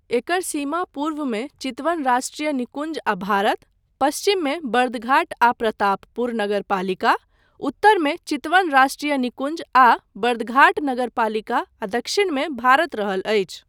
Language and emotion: Maithili, neutral